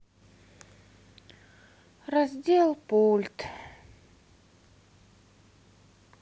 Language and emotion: Russian, sad